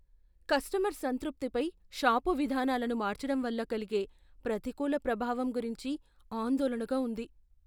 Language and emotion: Telugu, fearful